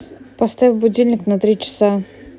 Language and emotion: Russian, neutral